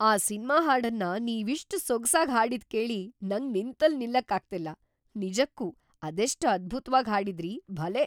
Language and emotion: Kannada, surprised